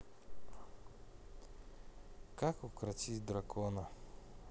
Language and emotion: Russian, neutral